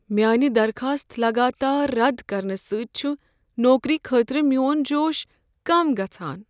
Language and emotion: Kashmiri, sad